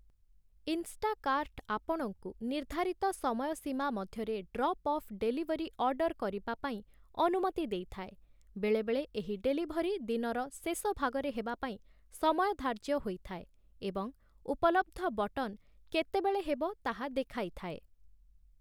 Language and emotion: Odia, neutral